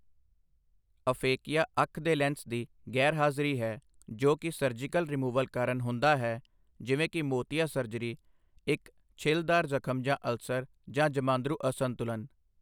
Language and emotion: Punjabi, neutral